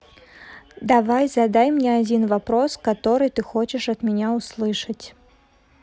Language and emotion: Russian, neutral